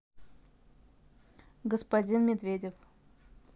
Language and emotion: Russian, neutral